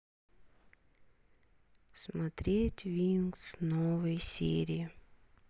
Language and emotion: Russian, sad